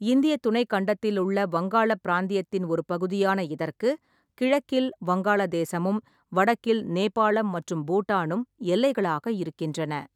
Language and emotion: Tamil, neutral